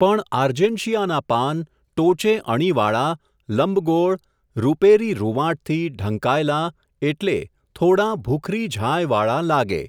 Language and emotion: Gujarati, neutral